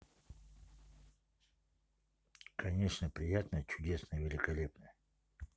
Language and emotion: Russian, neutral